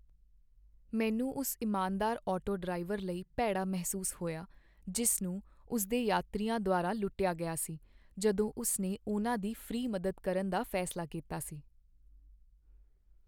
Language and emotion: Punjabi, sad